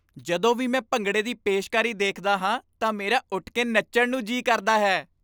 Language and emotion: Punjabi, happy